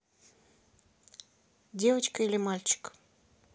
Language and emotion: Russian, neutral